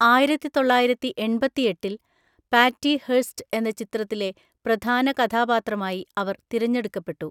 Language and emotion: Malayalam, neutral